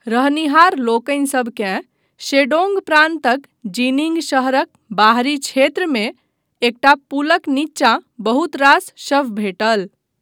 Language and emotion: Maithili, neutral